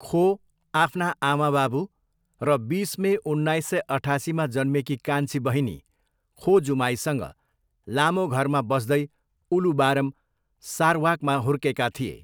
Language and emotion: Nepali, neutral